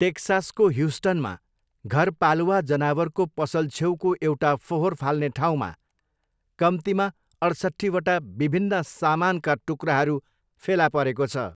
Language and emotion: Nepali, neutral